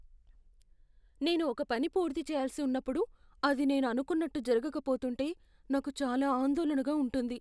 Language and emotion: Telugu, fearful